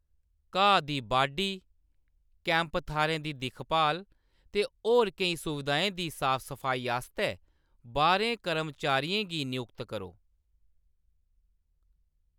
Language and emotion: Dogri, neutral